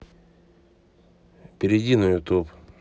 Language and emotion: Russian, neutral